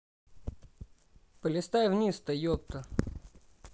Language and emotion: Russian, neutral